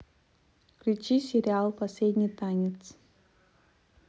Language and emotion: Russian, neutral